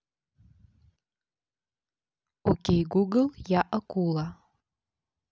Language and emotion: Russian, neutral